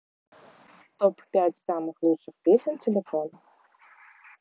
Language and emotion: Russian, neutral